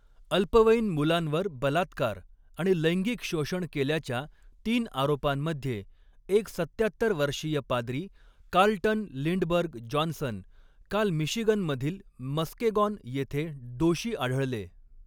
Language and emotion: Marathi, neutral